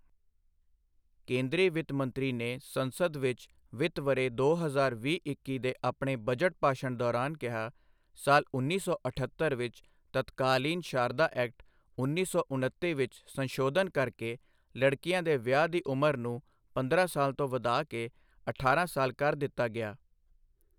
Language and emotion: Punjabi, neutral